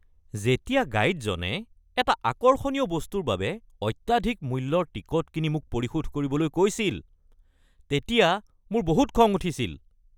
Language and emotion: Assamese, angry